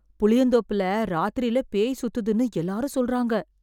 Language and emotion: Tamil, fearful